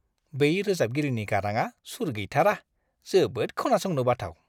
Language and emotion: Bodo, disgusted